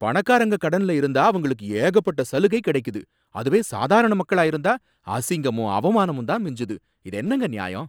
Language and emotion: Tamil, angry